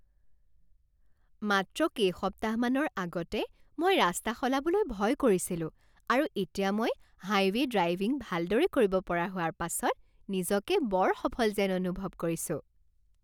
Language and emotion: Assamese, happy